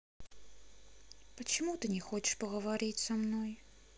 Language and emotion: Russian, sad